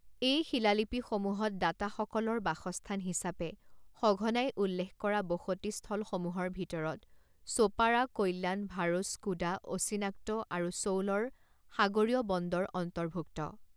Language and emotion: Assamese, neutral